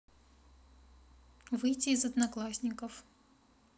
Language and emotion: Russian, neutral